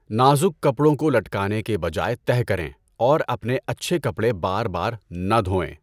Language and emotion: Urdu, neutral